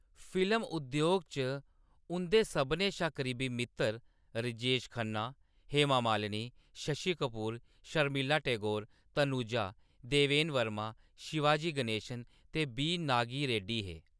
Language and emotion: Dogri, neutral